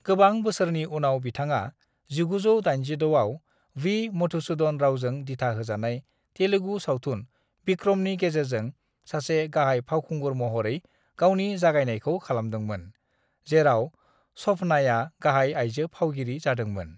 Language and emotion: Bodo, neutral